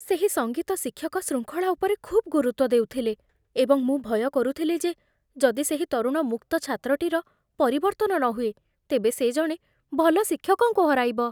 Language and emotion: Odia, fearful